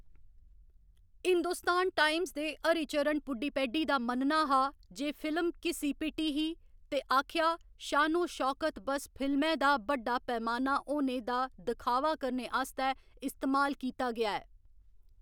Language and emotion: Dogri, neutral